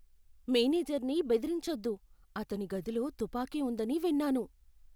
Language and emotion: Telugu, fearful